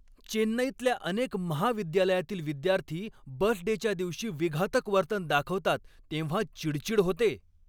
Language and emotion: Marathi, angry